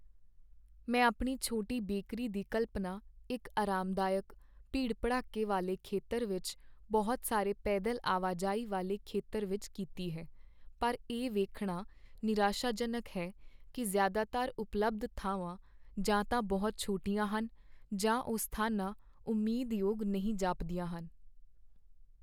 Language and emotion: Punjabi, sad